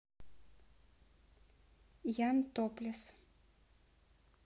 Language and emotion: Russian, neutral